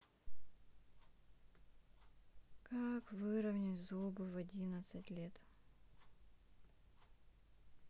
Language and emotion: Russian, sad